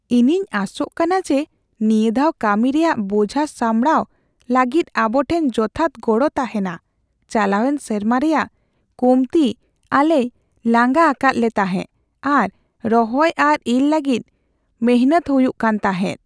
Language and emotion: Santali, fearful